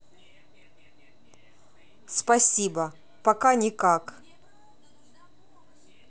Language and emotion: Russian, neutral